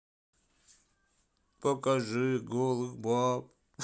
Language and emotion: Russian, sad